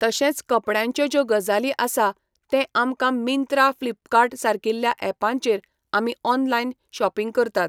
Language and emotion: Goan Konkani, neutral